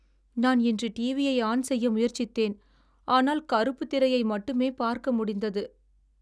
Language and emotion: Tamil, sad